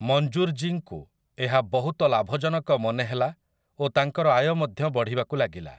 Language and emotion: Odia, neutral